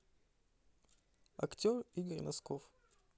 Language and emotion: Russian, neutral